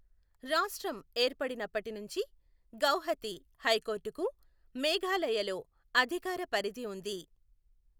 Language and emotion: Telugu, neutral